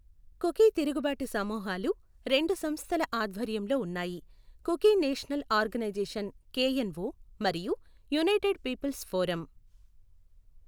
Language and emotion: Telugu, neutral